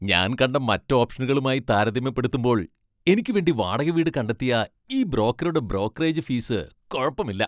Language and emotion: Malayalam, happy